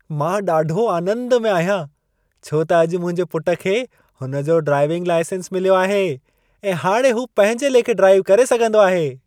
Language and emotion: Sindhi, happy